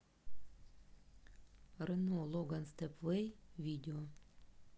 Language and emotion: Russian, neutral